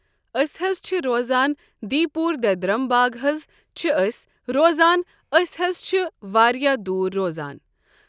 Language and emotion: Kashmiri, neutral